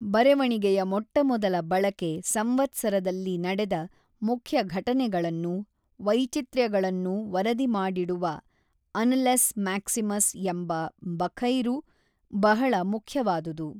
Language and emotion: Kannada, neutral